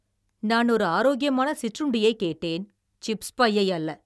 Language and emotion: Tamil, angry